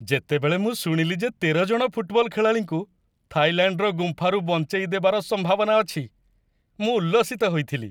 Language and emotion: Odia, happy